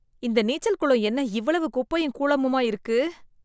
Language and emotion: Tamil, disgusted